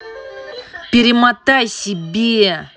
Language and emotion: Russian, angry